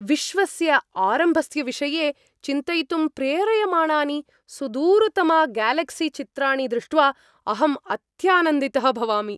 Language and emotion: Sanskrit, happy